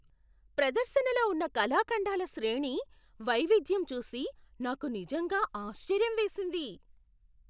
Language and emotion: Telugu, surprised